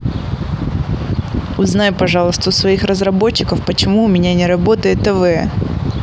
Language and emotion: Russian, angry